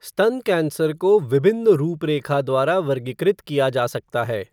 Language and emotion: Hindi, neutral